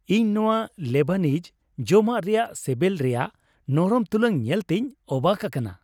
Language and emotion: Santali, happy